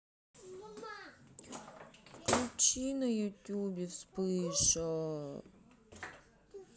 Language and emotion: Russian, sad